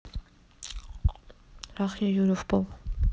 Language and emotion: Russian, neutral